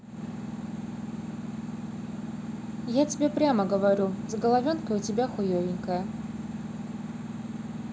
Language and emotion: Russian, neutral